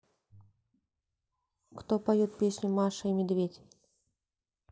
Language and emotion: Russian, neutral